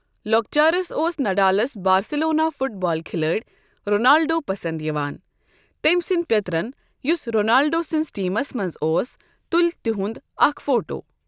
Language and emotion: Kashmiri, neutral